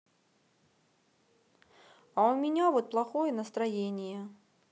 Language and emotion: Russian, sad